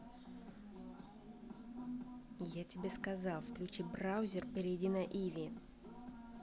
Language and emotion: Russian, angry